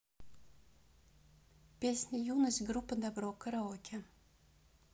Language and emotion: Russian, neutral